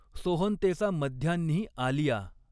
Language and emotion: Marathi, neutral